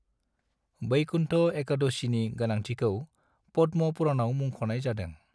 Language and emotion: Bodo, neutral